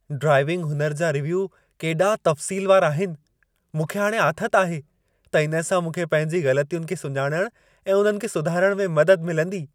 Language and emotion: Sindhi, happy